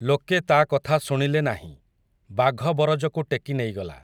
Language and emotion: Odia, neutral